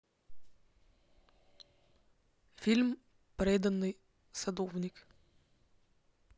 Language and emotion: Russian, neutral